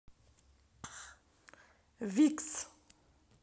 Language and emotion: Russian, positive